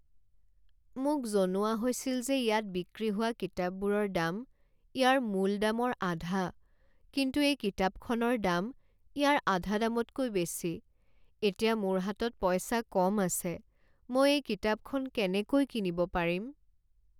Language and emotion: Assamese, sad